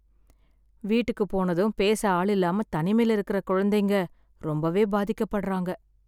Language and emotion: Tamil, sad